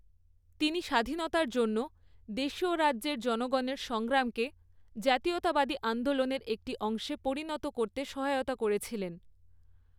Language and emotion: Bengali, neutral